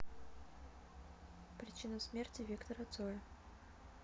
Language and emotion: Russian, neutral